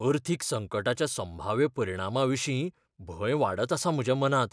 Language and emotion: Goan Konkani, fearful